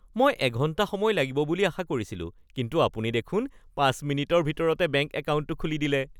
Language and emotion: Assamese, happy